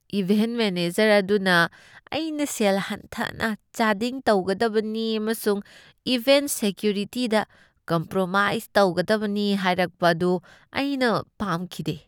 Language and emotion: Manipuri, disgusted